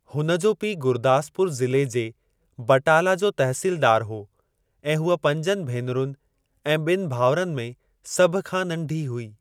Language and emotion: Sindhi, neutral